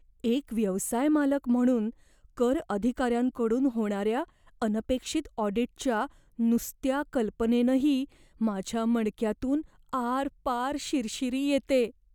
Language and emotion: Marathi, fearful